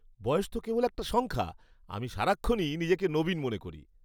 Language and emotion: Bengali, happy